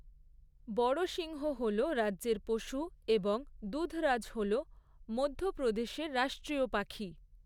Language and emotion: Bengali, neutral